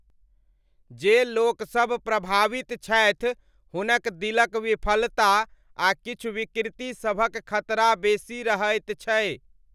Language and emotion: Maithili, neutral